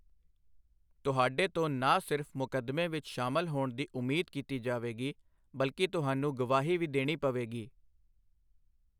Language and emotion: Punjabi, neutral